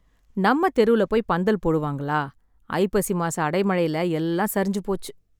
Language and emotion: Tamil, sad